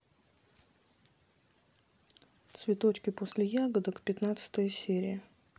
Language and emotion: Russian, neutral